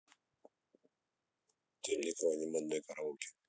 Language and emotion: Russian, neutral